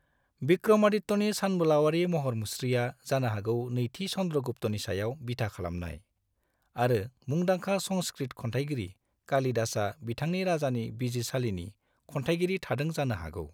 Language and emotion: Bodo, neutral